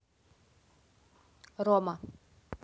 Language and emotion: Russian, neutral